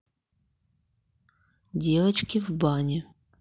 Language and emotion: Russian, neutral